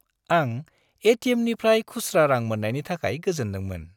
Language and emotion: Bodo, happy